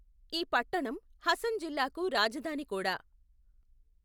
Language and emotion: Telugu, neutral